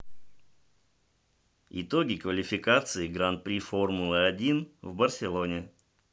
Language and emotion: Russian, neutral